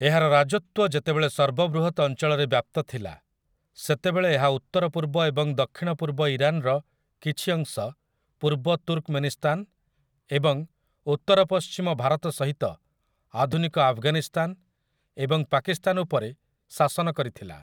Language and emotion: Odia, neutral